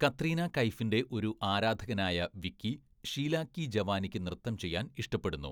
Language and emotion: Malayalam, neutral